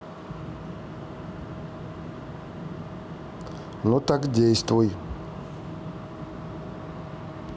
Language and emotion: Russian, neutral